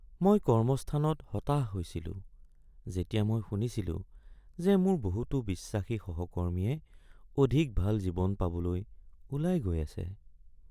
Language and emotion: Assamese, sad